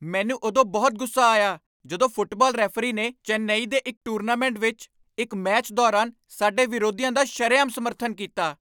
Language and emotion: Punjabi, angry